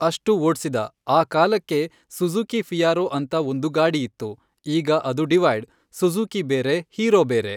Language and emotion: Kannada, neutral